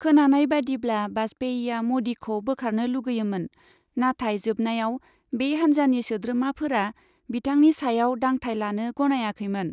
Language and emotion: Bodo, neutral